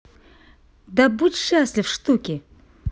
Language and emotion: Russian, positive